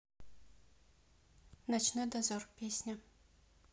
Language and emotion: Russian, neutral